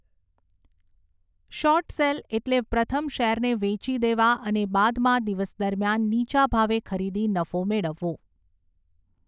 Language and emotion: Gujarati, neutral